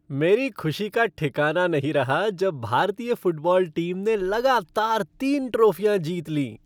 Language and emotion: Hindi, happy